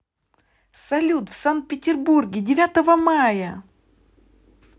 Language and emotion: Russian, positive